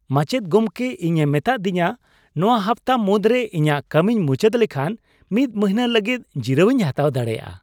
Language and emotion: Santali, happy